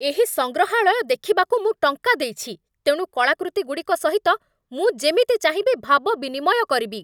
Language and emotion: Odia, angry